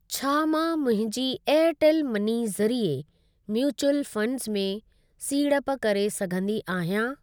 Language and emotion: Sindhi, neutral